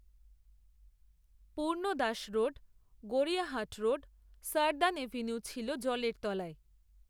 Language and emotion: Bengali, neutral